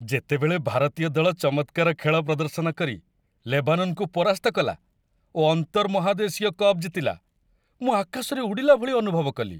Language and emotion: Odia, happy